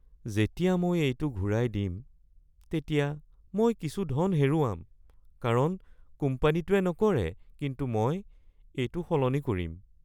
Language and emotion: Assamese, sad